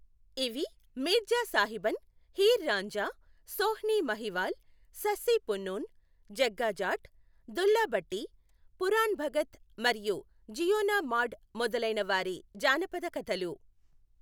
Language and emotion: Telugu, neutral